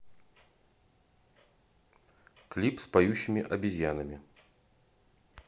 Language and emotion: Russian, neutral